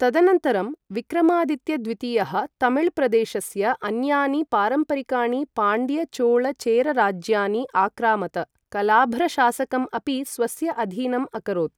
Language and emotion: Sanskrit, neutral